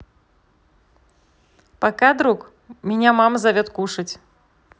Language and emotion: Russian, positive